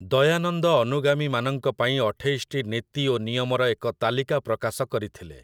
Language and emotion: Odia, neutral